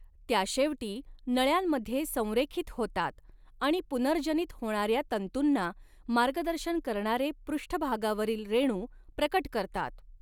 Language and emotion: Marathi, neutral